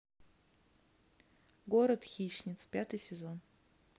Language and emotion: Russian, neutral